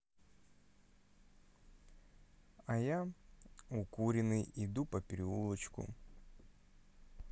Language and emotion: Russian, neutral